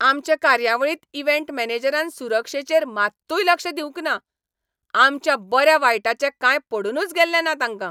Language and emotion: Goan Konkani, angry